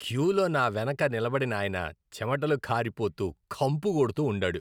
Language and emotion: Telugu, disgusted